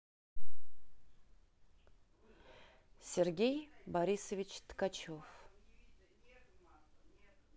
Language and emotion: Russian, neutral